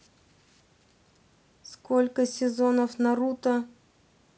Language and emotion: Russian, neutral